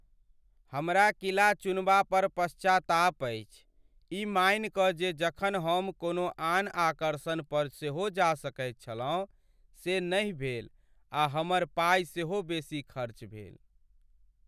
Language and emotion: Maithili, sad